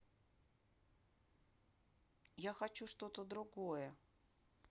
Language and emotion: Russian, sad